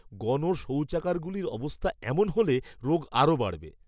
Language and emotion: Bengali, disgusted